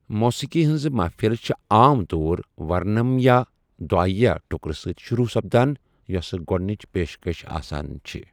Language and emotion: Kashmiri, neutral